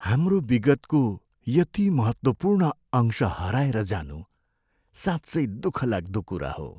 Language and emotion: Nepali, sad